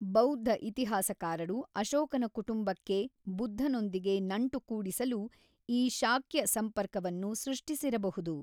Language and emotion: Kannada, neutral